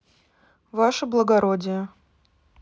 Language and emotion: Russian, neutral